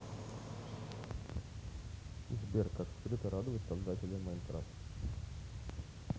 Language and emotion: Russian, neutral